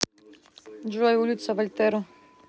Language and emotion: Russian, neutral